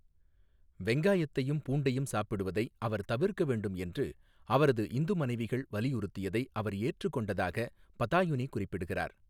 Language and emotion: Tamil, neutral